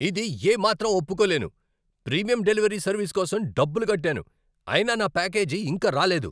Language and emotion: Telugu, angry